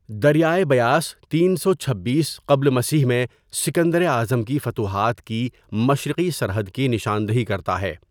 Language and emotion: Urdu, neutral